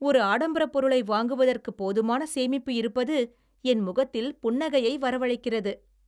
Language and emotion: Tamil, happy